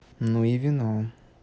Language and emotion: Russian, neutral